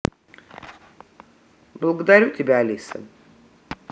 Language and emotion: Russian, neutral